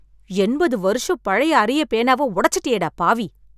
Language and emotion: Tamil, angry